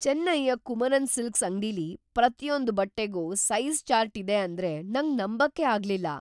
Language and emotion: Kannada, surprised